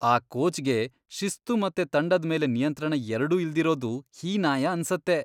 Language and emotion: Kannada, disgusted